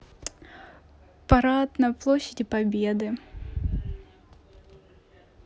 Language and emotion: Russian, neutral